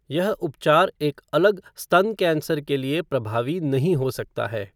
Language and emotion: Hindi, neutral